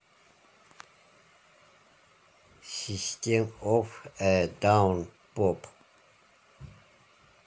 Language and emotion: Russian, neutral